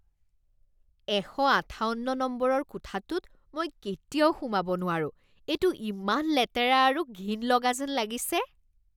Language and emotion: Assamese, disgusted